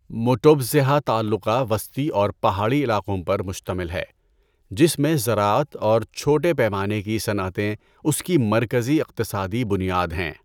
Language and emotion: Urdu, neutral